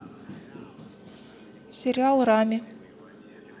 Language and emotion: Russian, neutral